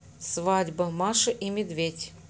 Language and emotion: Russian, neutral